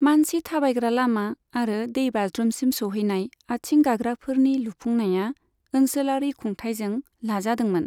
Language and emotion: Bodo, neutral